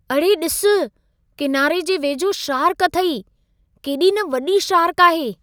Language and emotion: Sindhi, surprised